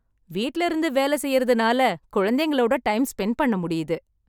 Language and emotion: Tamil, happy